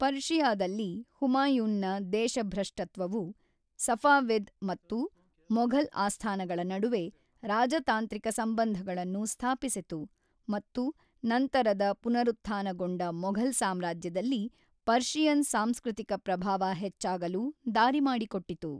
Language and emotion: Kannada, neutral